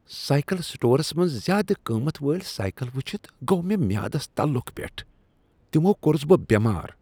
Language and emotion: Kashmiri, disgusted